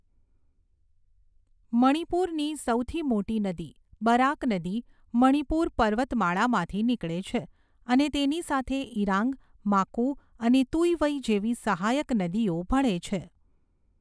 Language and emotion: Gujarati, neutral